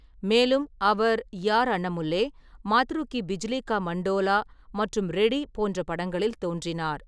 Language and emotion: Tamil, neutral